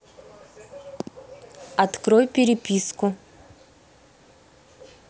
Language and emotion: Russian, neutral